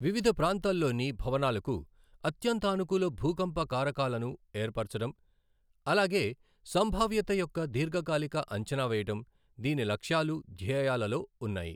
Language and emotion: Telugu, neutral